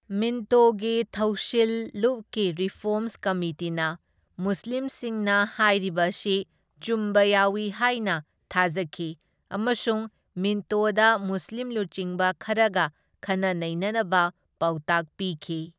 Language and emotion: Manipuri, neutral